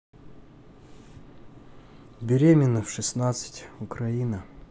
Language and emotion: Russian, neutral